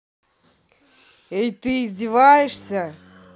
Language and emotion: Russian, angry